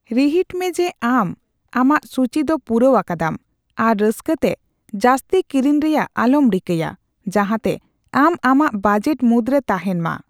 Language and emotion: Santali, neutral